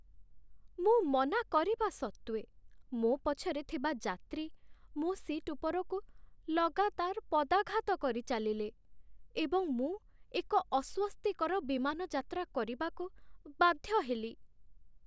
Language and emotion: Odia, sad